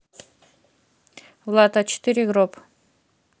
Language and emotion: Russian, neutral